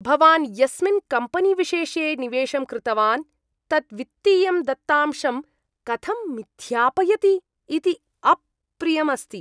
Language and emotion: Sanskrit, disgusted